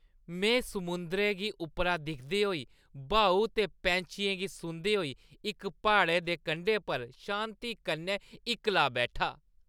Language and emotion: Dogri, happy